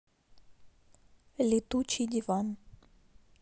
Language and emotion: Russian, neutral